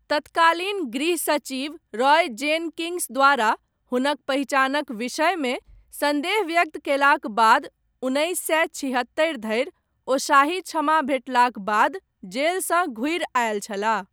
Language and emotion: Maithili, neutral